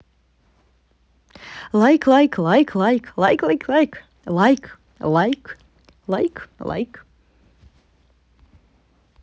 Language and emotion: Russian, positive